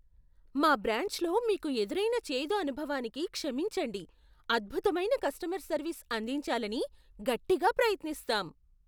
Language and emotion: Telugu, surprised